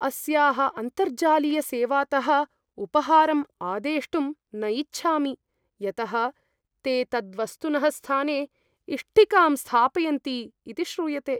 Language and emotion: Sanskrit, fearful